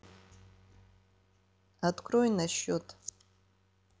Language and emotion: Russian, neutral